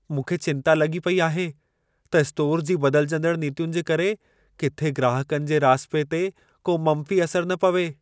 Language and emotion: Sindhi, fearful